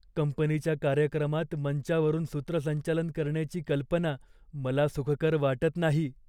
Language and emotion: Marathi, fearful